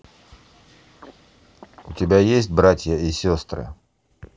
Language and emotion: Russian, neutral